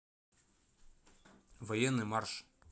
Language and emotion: Russian, neutral